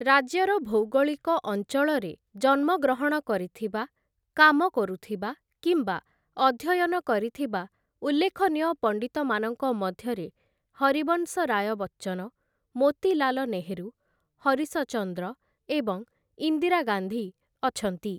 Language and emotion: Odia, neutral